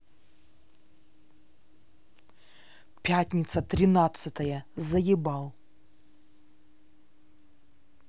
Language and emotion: Russian, angry